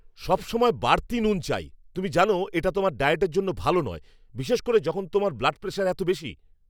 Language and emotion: Bengali, angry